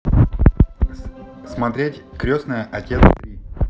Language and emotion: Russian, neutral